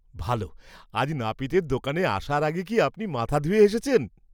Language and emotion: Bengali, surprised